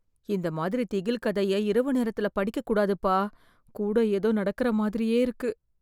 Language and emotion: Tamil, fearful